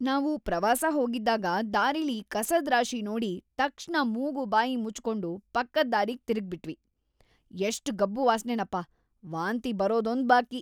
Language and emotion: Kannada, disgusted